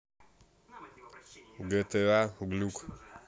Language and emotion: Russian, neutral